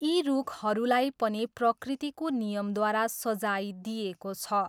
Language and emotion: Nepali, neutral